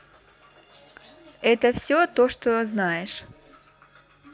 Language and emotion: Russian, neutral